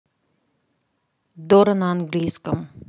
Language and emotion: Russian, neutral